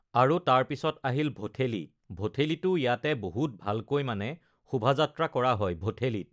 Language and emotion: Assamese, neutral